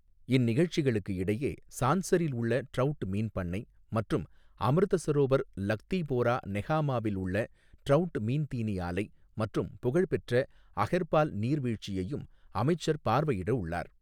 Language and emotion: Tamil, neutral